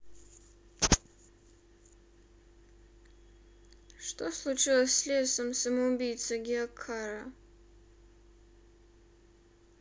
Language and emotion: Russian, sad